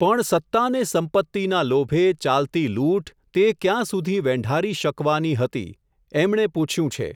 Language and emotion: Gujarati, neutral